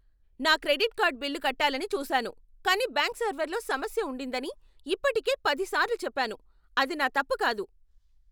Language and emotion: Telugu, angry